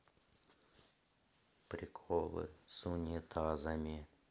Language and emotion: Russian, sad